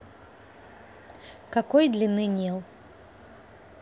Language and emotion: Russian, neutral